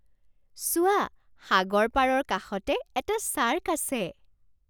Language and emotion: Assamese, surprised